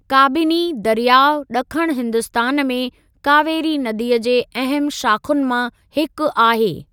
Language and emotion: Sindhi, neutral